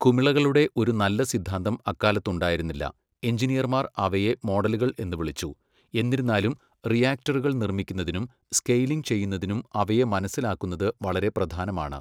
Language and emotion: Malayalam, neutral